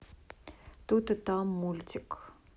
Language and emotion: Russian, neutral